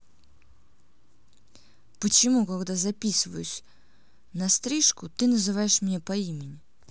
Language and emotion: Russian, angry